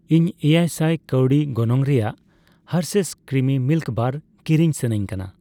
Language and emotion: Santali, neutral